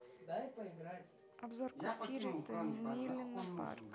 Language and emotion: Russian, neutral